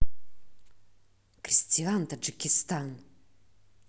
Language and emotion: Russian, angry